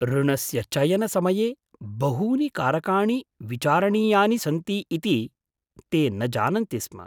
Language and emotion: Sanskrit, surprised